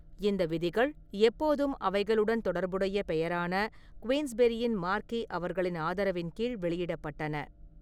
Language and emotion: Tamil, neutral